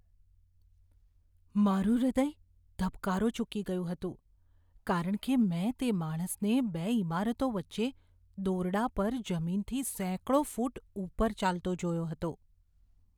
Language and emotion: Gujarati, fearful